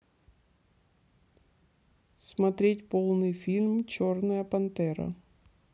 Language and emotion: Russian, neutral